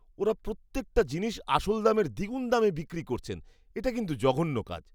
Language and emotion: Bengali, disgusted